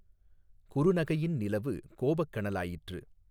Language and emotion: Tamil, neutral